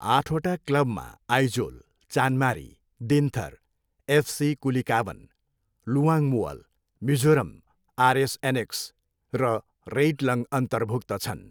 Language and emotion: Nepali, neutral